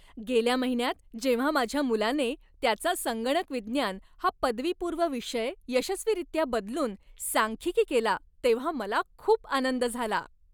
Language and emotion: Marathi, happy